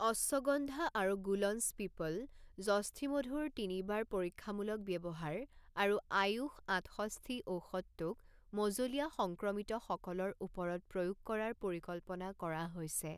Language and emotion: Assamese, neutral